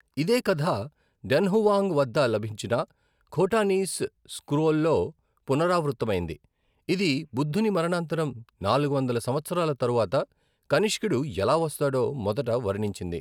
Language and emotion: Telugu, neutral